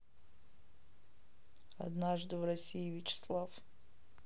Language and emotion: Russian, neutral